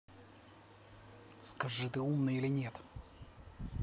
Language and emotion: Russian, angry